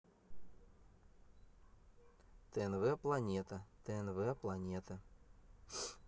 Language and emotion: Russian, neutral